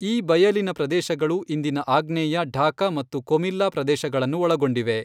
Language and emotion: Kannada, neutral